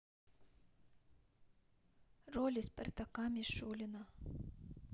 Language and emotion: Russian, sad